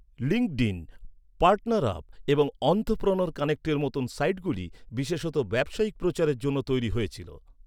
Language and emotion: Bengali, neutral